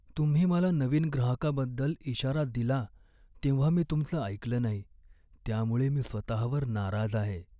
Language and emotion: Marathi, sad